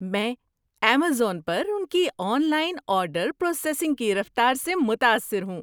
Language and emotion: Urdu, surprised